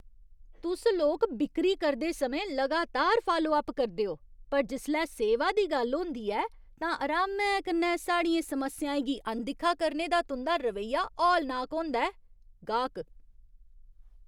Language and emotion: Dogri, disgusted